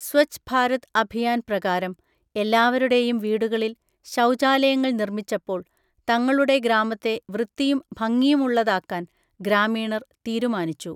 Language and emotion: Malayalam, neutral